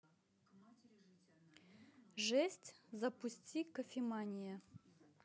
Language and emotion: Russian, neutral